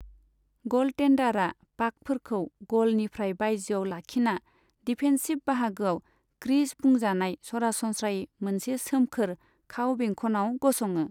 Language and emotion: Bodo, neutral